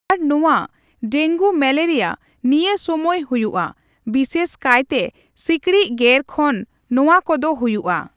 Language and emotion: Santali, neutral